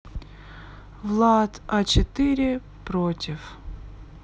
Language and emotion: Russian, sad